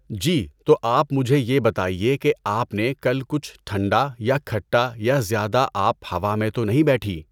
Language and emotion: Urdu, neutral